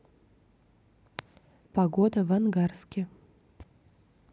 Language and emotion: Russian, neutral